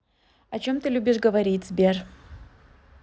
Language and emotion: Russian, neutral